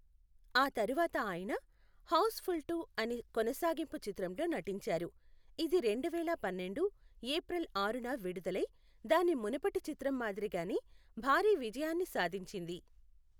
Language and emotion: Telugu, neutral